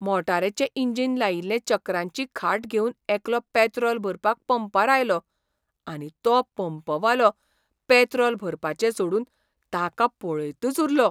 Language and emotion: Goan Konkani, surprised